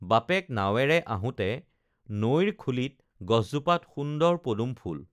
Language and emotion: Assamese, neutral